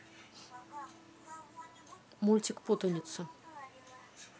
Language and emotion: Russian, neutral